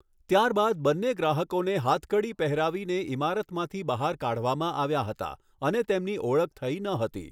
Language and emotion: Gujarati, neutral